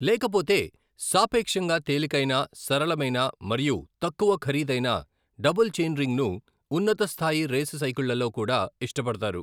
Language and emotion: Telugu, neutral